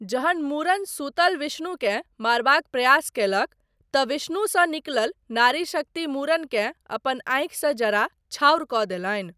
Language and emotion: Maithili, neutral